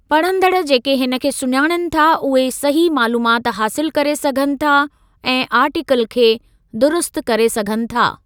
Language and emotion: Sindhi, neutral